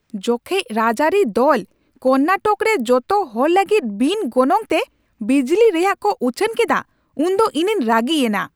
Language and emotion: Santali, angry